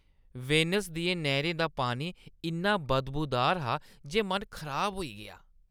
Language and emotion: Dogri, disgusted